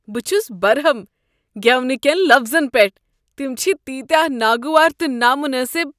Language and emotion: Kashmiri, disgusted